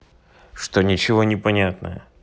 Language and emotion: Russian, neutral